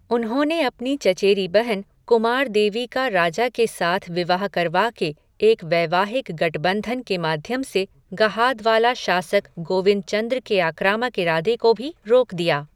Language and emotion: Hindi, neutral